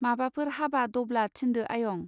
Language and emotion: Bodo, neutral